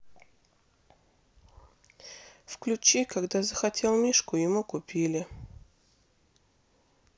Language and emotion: Russian, sad